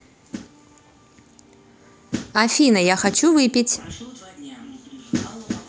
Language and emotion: Russian, positive